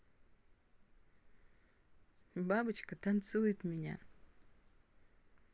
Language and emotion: Russian, positive